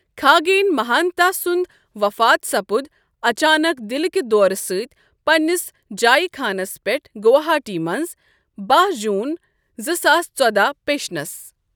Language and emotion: Kashmiri, neutral